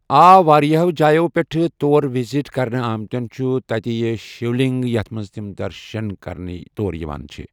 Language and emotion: Kashmiri, neutral